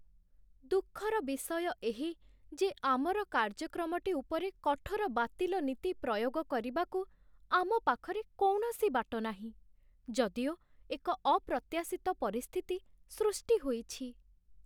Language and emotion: Odia, sad